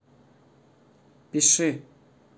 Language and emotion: Russian, neutral